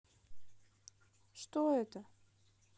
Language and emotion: Russian, neutral